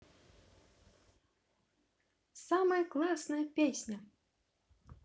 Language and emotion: Russian, positive